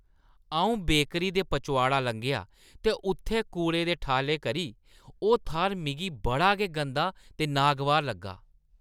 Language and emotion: Dogri, disgusted